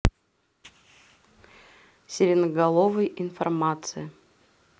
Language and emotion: Russian, neutral